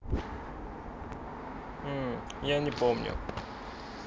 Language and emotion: Russian, neutral